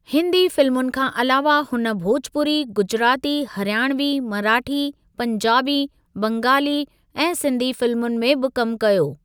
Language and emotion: Sindhi, neutral